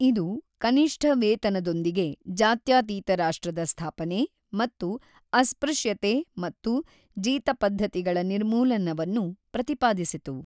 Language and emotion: Kannada, neutral